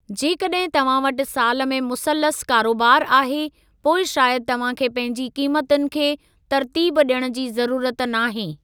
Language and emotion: Sindhi, neutral